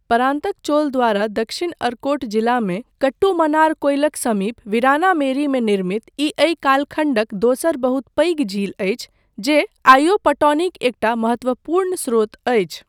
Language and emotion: Maithili, neutral